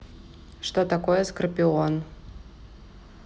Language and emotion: Russian, neutral